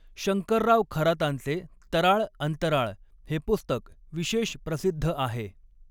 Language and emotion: Marathi, neutral